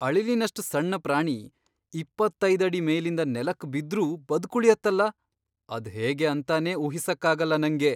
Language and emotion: Kannada, surprised